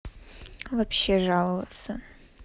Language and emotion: Russian, neutral